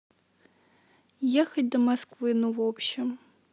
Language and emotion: Russian, neutral